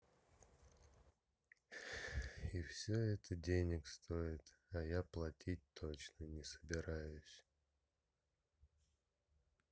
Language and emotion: Russian, sad